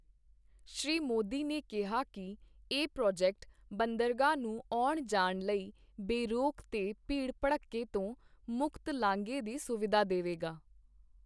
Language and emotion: Punjabi, neutral